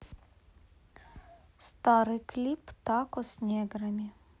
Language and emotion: Russian, neutral